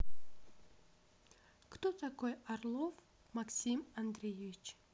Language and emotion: Russian, neutral